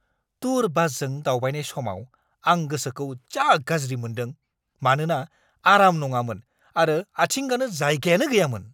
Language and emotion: Bodo, angry